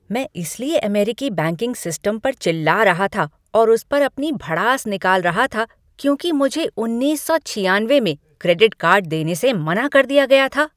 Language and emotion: Hindi, angry